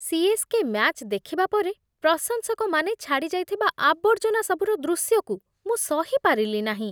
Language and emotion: Odia, disgusted